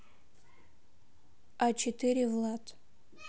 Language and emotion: Russian, neutral